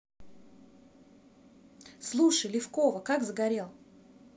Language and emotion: Russian, positive